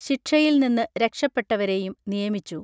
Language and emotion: Malayalam, neutral